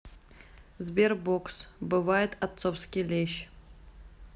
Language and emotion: Russian, neutral